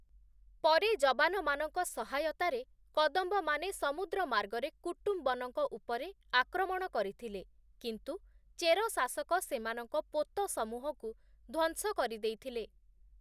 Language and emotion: Odia, neutral